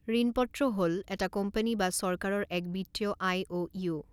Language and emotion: Assamese, neutral